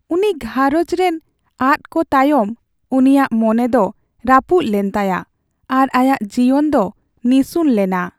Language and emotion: Santali, sad